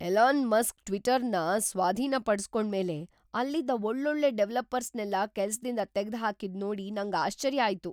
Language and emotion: Kannada, surprised